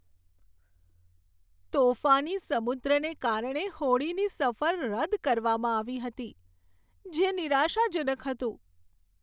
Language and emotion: Gujarati, sad